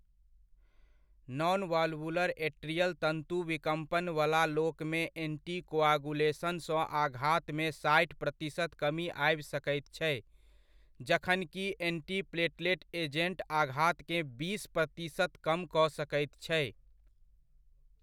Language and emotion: Maithili, neutral